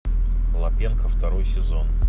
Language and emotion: Russian, neutral